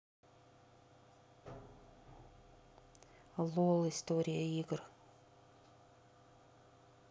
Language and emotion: Russian, neutral